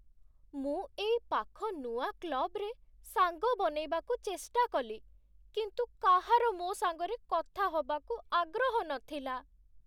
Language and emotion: Odia, sad